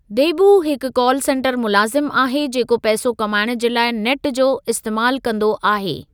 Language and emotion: Sindhi, neutral